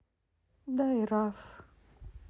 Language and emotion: Russian, sad